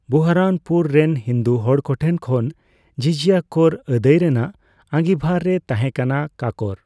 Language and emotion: Santali, neutral